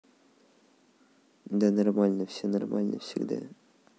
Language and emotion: Russian, neutral